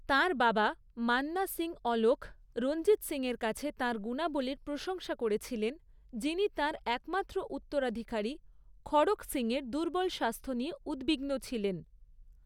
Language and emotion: Bengali, neutral